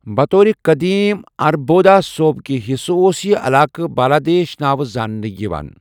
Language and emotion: Kashmiri, neutral